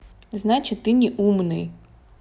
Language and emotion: Russian, neutral